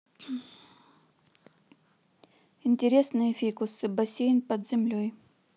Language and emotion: Russian, neutral